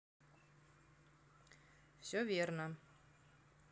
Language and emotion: Russian, neutral